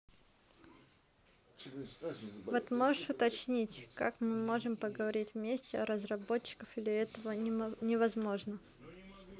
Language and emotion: Russian, neutral